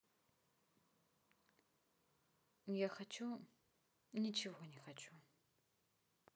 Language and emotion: Russian, sad